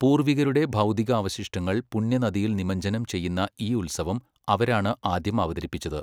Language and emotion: Malayalam, neutral